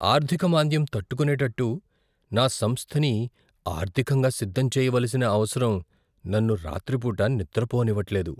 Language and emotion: Telugu, fearful